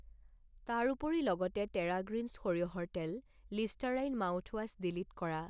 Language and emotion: Assamese, neutral